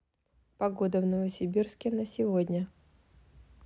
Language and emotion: Russian, neutral